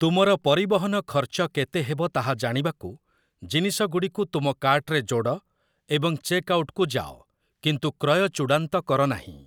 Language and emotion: Odia, neutral